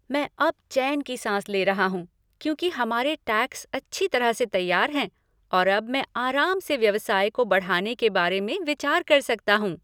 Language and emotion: Hindi, happy